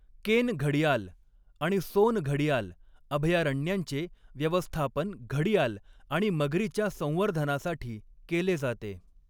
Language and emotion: Marathi, neutral